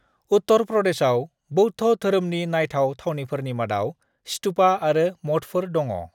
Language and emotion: Bodo, neutral